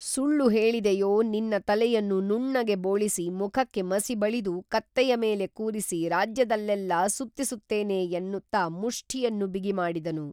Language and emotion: Kannada, neutral